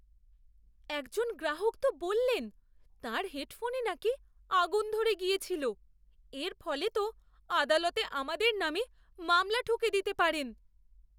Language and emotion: Bengali, fearful